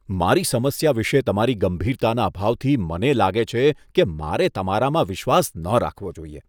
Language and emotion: Gujarati, disgusted